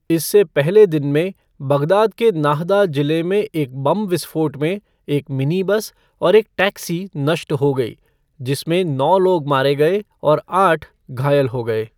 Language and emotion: Hindi, neutral